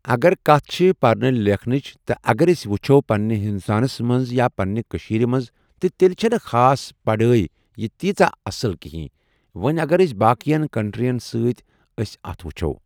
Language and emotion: Kashmiri, neutral